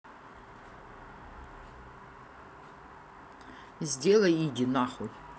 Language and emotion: Russian, angry